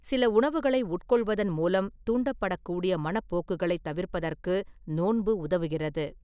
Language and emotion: Tamil, neutral